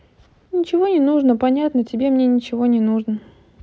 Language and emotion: Russian, sad